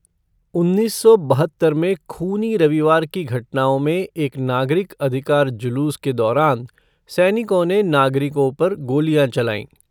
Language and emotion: Hindi, neutral